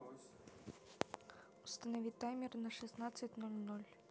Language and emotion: Russian, neutral